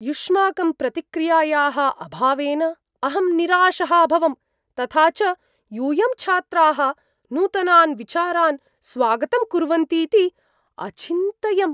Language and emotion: Sanskrit, surprised